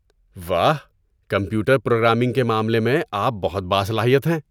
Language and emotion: Urdu, surprised